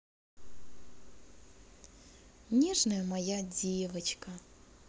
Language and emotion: Russian, positive